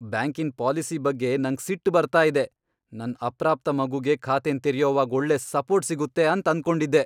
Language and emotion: Kannada, angry